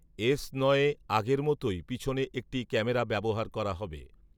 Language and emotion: Bengali, neutral